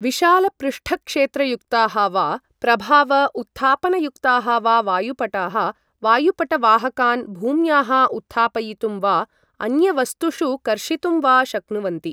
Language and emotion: Sanskrit, neutral